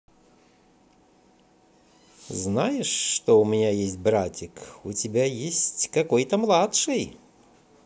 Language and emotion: Russian, positive